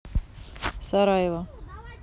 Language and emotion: Russian, neutral